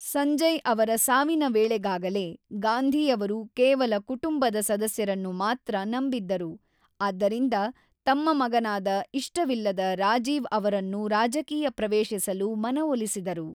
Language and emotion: Kannada, neutral